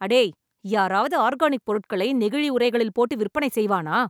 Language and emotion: Tamil, angry